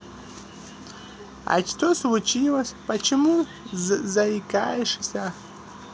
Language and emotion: Russian, positive